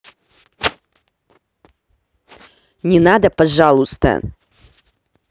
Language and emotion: Russian, angry